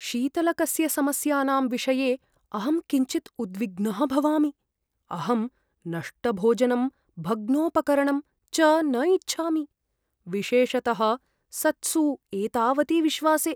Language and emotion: Sanskrit, fearful